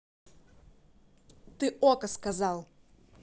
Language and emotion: Russian, angry